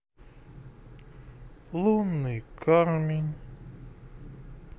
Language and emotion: Russian, sad